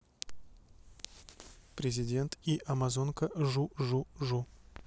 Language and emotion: Russian, neutral